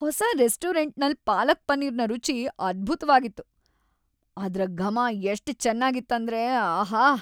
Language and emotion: Kannada, happy